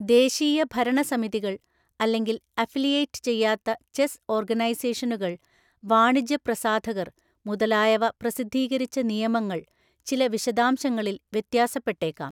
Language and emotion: Malayalam, neutral